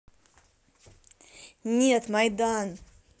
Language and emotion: Russian, angry